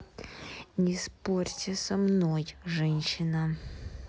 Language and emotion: Russian, angry